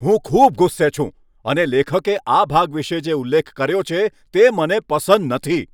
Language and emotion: Gujarati, angry